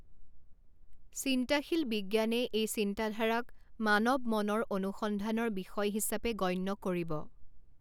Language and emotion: Assamese, neutral